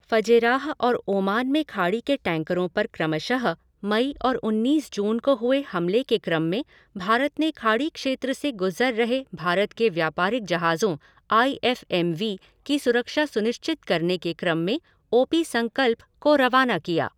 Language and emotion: Hindi, neutral